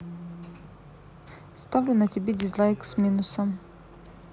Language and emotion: Russian, neutral